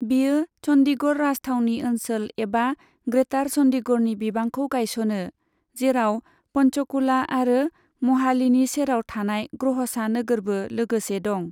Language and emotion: Bodo, neutral